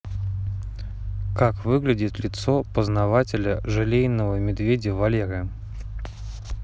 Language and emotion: Russian, neutral